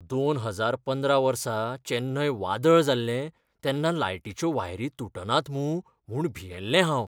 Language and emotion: Goan Konkani, fearful